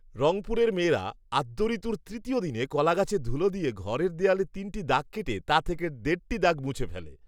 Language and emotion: Bengali, neutral